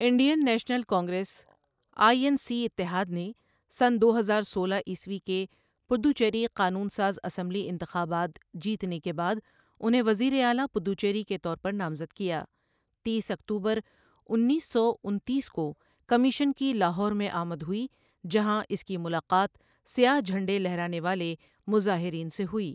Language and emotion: Urdu, neutral